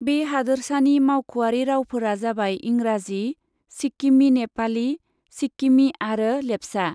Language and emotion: Bodo, neutral